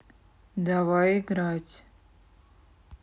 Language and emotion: Russian, neutral